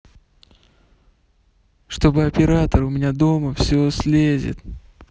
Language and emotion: Russian, neutral